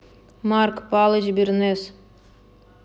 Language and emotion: Russian, angry